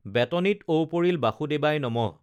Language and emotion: Assamese, neutral